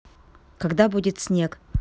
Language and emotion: Russian, neutral